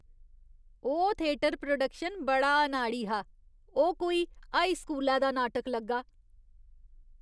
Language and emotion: Dogri, disgusted